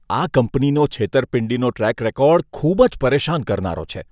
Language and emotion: Gujarati, disgusted